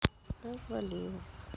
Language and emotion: Russian, sad